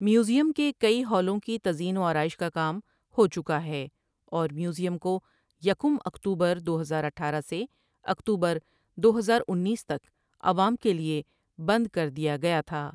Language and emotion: Urdu, neutral